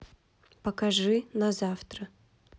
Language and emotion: Russian, neutral